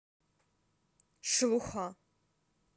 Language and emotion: Russian, neutral